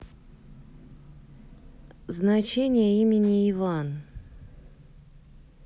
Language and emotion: Russian, neutral